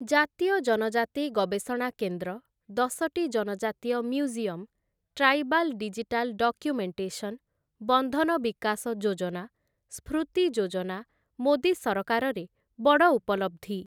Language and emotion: Odia, neutral